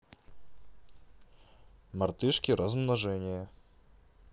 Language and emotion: Russian, neutral